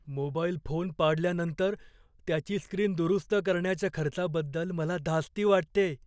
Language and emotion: Marathi, fearful